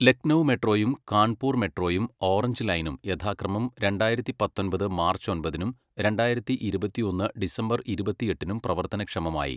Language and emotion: Malayalam, neutral